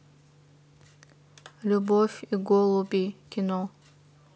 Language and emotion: Russian, neutral